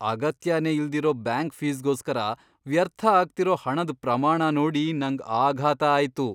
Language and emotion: Kannada, surprised